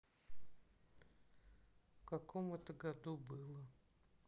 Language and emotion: Russian, sad